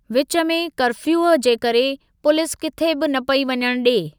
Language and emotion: Sindhi, neutral